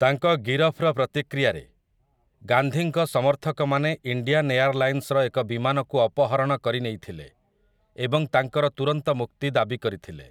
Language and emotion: Odia, neutral